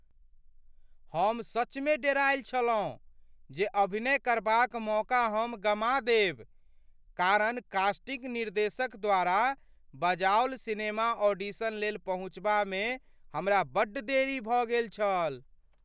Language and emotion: Maithili, fearful